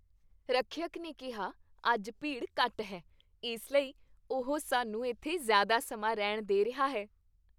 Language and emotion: Punjabi, happy